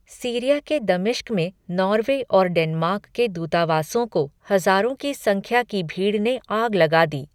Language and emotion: Hindi, neutral